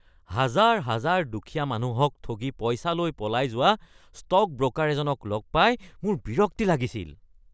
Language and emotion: Assamese, disgusted